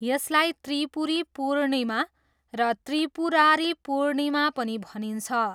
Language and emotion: Nepali, neutral